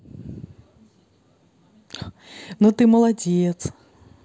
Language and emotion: Russian, positive